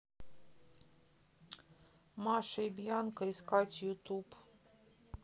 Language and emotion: Russian, neutral